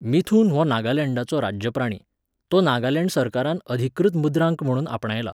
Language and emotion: Goan Konkani, neutral